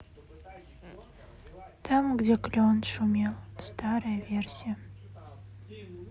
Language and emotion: Russian, sad